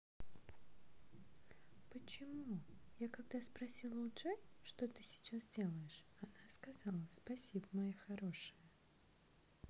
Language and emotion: Russian, neutral